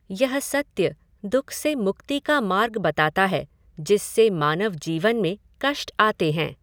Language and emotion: Hindi, neutral